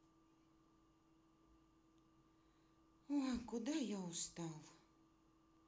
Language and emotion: Russian, sad